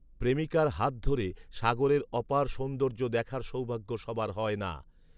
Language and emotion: Bengali, neutral